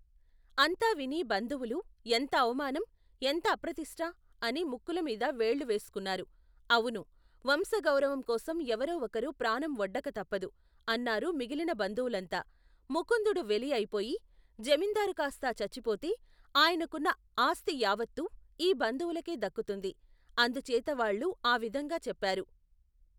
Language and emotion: Telugu, neutral